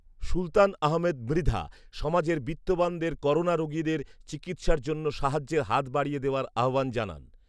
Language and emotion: Bengali, neutral